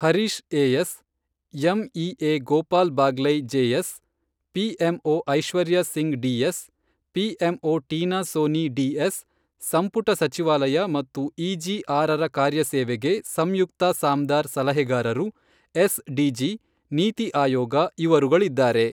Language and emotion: Kannada, neutral